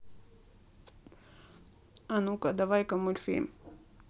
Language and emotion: Russian, neutral